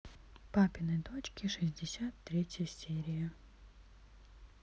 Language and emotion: Russian, neutral